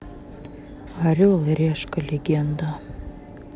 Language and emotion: Russian, neutral